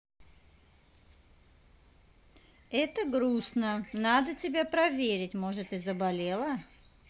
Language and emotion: Russian, neutral